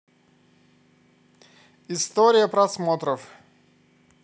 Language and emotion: Russian, positive